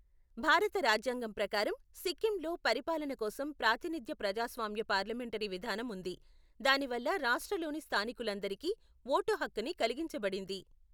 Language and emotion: Telugu, neutral